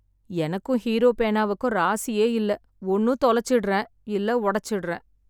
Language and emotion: Tamil, sad